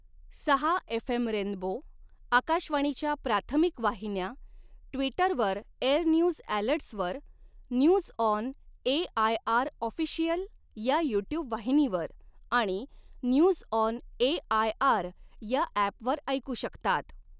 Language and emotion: Marathi, neutral